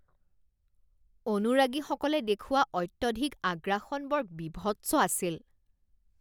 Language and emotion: Assamese, disgusted